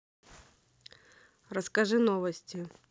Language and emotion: Russian, neutral